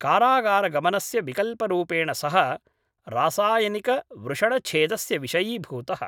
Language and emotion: Sanskrit, neutral